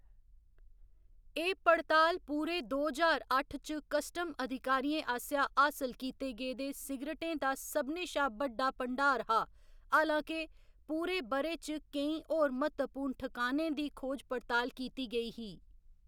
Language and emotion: Dogri, neutral